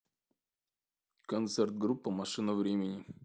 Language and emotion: Russian, neutral